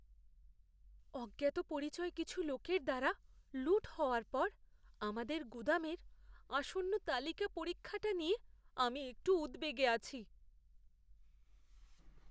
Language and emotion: Bengali, fearful